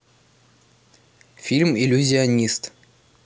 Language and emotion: Russian, neutral